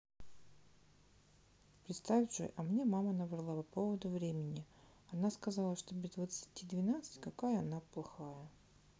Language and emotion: Russian, neutral